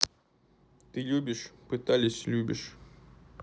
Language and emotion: Russian, neutral